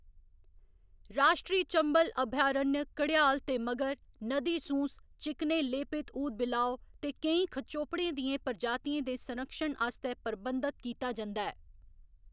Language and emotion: Dogri, neutral